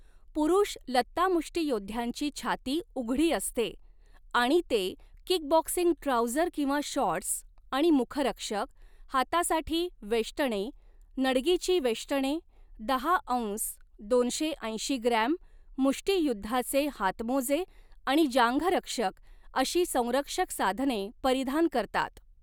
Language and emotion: Marathi, neutral